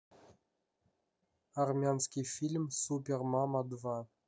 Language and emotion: Russian, neutral